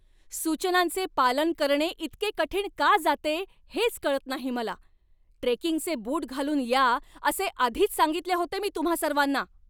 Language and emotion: Marathi, angry